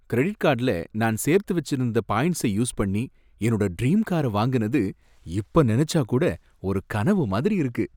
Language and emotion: Tamil, happy